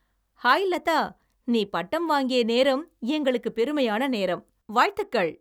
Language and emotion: Tamil, happy